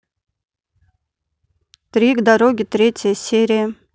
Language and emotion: Russian, neutral